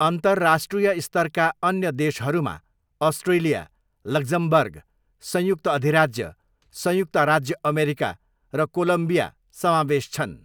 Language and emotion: Nepali, neutral